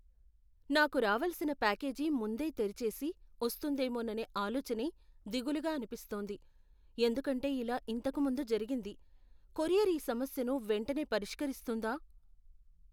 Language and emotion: Telugu, fearful